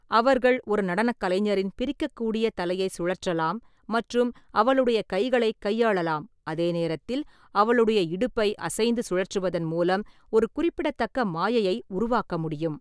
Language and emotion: Tamil, neutral